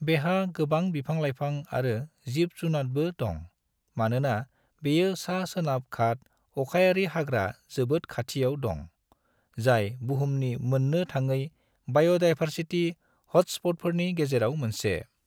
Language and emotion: Bodo, neutral